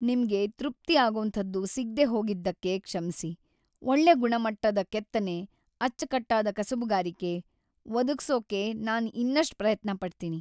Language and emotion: Kannada, sad